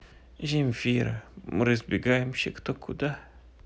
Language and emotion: Russian, sad